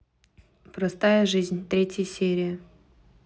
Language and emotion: Russian, neutral